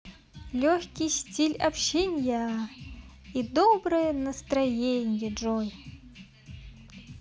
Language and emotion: Russian, positive